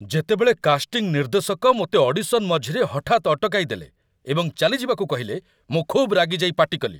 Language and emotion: Odia, angry